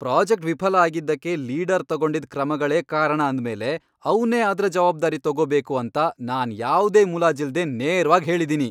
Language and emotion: Kannada, angry